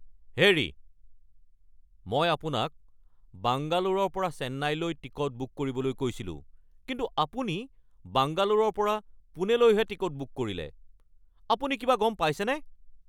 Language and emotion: Assamese, angry